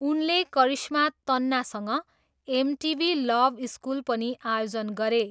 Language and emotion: Nepali, neutral